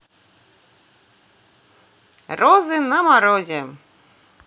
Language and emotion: Russian, positive